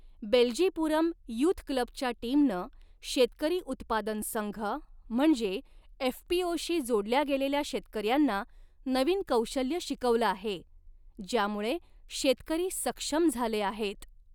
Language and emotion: Marathi, neutral